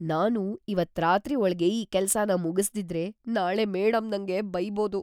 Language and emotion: Kannada, fearful